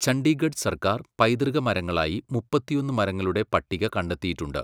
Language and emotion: Malayalam, neutral